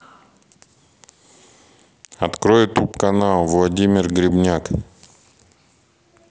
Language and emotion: Russian, neutral